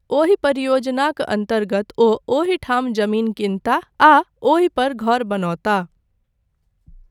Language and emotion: Maithili, neutral